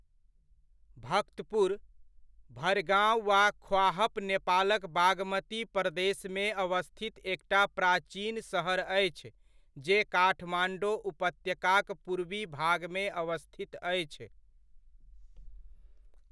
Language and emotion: Maithili, neutral